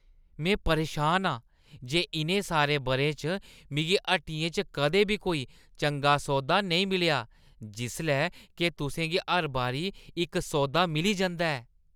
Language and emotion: Dogri, disgusted